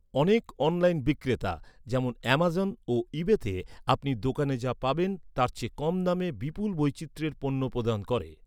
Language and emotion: Bengali, neutral